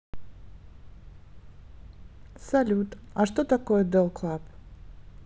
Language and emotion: Russian, neutral